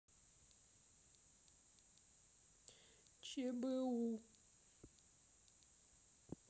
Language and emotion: Russian, sad